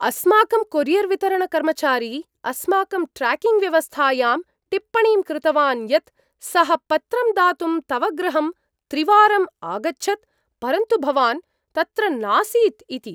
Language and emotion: Sanskrit, surprised